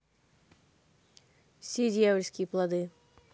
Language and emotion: Russian, neutral